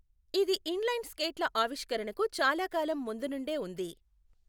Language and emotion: Telugu, neutral